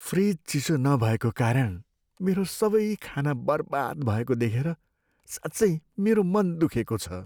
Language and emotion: Nepali, sad